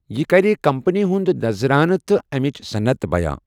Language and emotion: Kashmiri, neutral